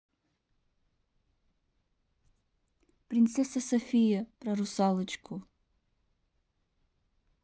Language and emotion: Russian, neutral